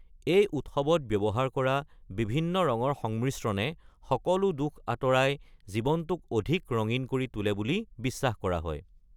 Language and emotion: Assamese, neutral